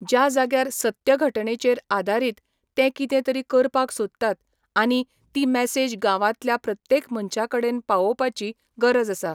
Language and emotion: Goan Konkani, neutral